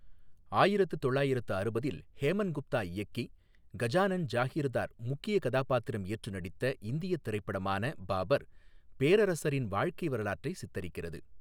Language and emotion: Tamil, neutral